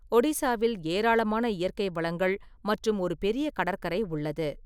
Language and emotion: Tamil, neutral